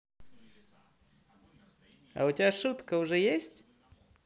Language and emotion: Russian, positive